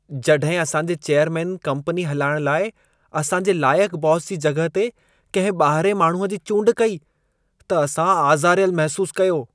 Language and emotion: Sindhi, disgusted